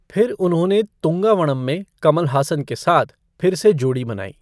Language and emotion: Hindi, neutral